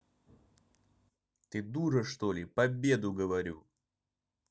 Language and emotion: Russian, angry